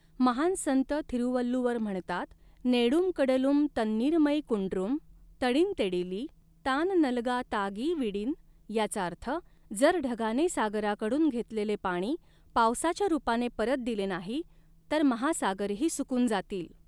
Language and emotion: Marathi, neutral